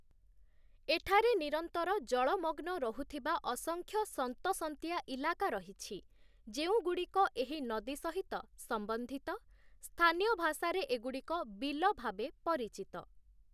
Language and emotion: Odia, neutral